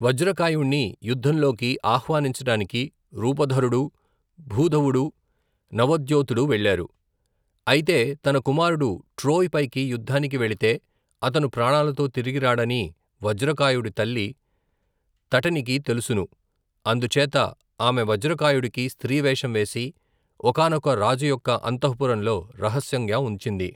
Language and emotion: Telugu, neutral